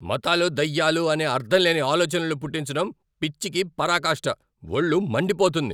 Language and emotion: Telugu, angry